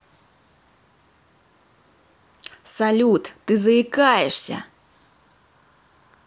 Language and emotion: Russian, angry